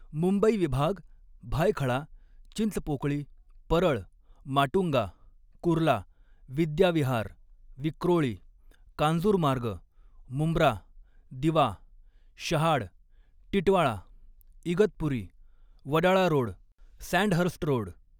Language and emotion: Marathi, neutral